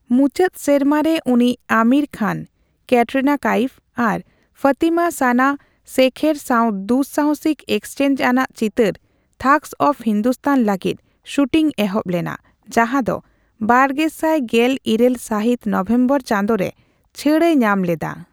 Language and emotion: Santali, neutral